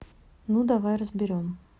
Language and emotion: Russian, neutral